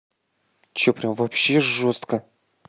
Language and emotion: Russian, angry